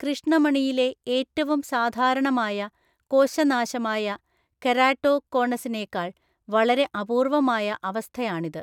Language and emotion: Malayalam, neutral